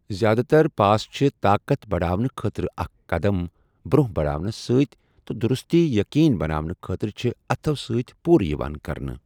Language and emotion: Kashmiri, neutral